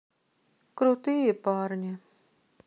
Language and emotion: Russian, sad